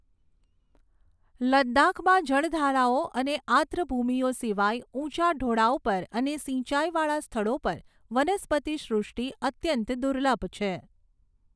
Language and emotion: Gujarati, neutral